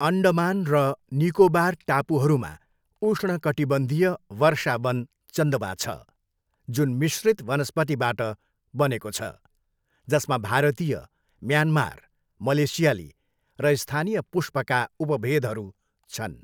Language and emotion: Nepali, neutral